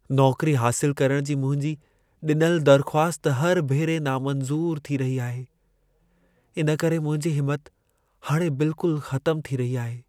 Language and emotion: Sindhi, sad